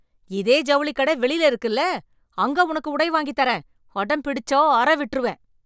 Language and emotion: Tamil, angry